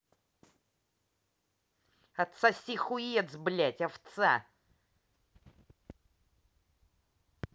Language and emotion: Russian, angry